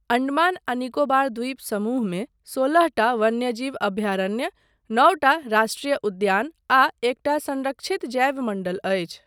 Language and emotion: Maithili, neutral